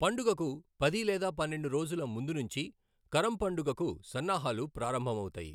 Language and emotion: Telugu, neutral